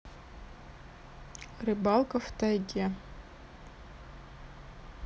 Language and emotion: Russian, neutral